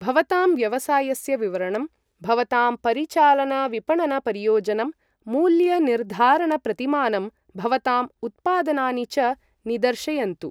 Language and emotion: Sanskrit, neutral